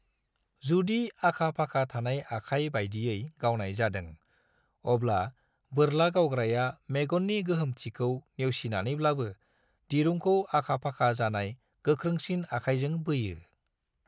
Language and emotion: Bodo, neutral